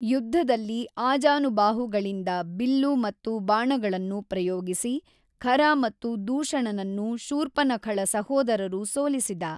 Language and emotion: Kannada, neutral